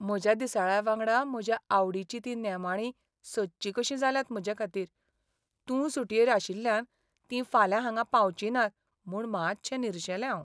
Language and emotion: Goan Konkani, sad